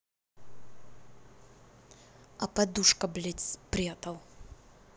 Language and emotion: Russian, angry